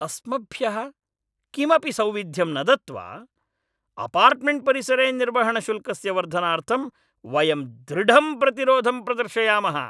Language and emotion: Sanskrit, angry